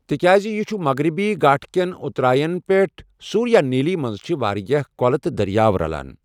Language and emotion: Kashmiri, neutral